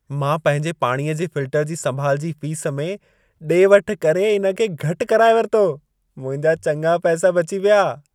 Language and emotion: Sindhi, happy